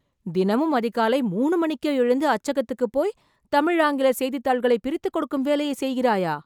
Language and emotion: Tamil, surprised